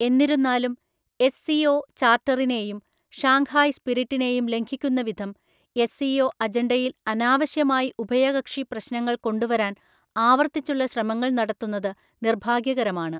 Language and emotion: Malayalam, neutral